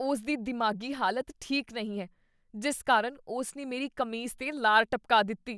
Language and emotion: Punjabi, disgusted